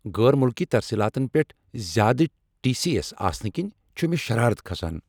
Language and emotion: Kashmiri, angry